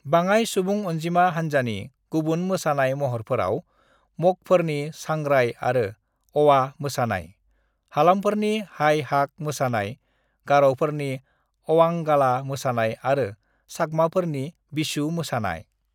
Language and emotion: Bodo, neutral